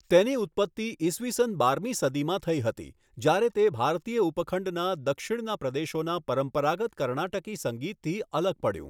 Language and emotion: Gujarati, neutral